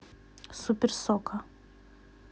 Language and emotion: Russian, neutral